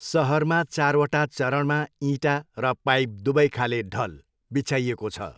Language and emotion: Nepali, neutral